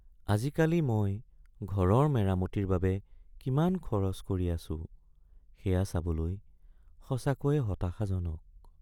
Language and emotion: Assamese, sad